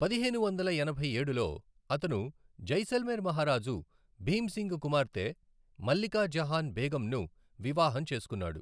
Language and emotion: Telugu, neutral